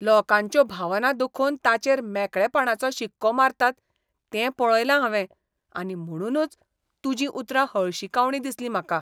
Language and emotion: Goan Konkani, disgusted